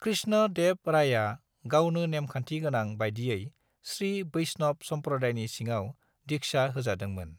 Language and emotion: Bodo, neutral